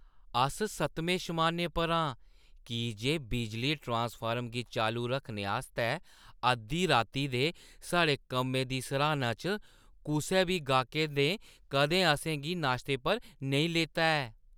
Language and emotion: Dogri, happy